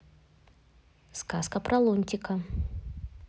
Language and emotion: Russian, neutral